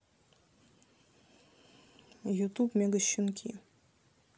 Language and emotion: Russian, neutral